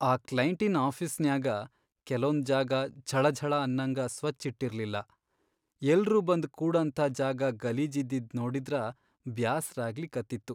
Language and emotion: Kannada, sad